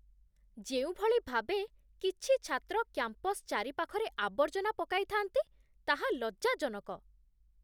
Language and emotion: Odia, disgusted